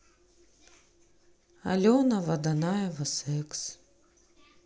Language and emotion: Russian, sad